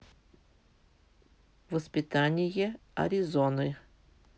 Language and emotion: Russian, neutral